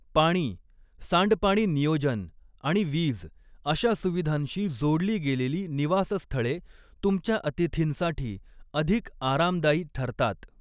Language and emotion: Marathi, neutral